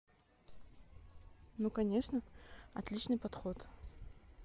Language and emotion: Russian, neutral